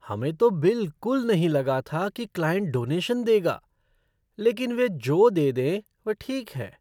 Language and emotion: Hindi, surprised